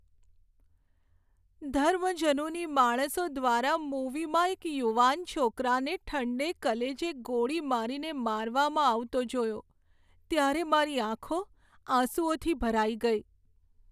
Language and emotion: Gujarati, sad